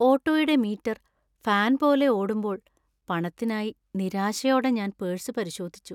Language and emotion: Malayalam, sad